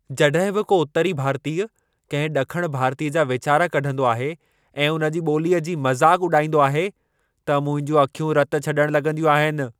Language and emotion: Sindhi, angry